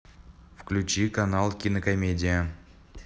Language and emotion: Russian, neutral